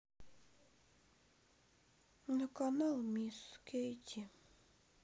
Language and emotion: Russian, sad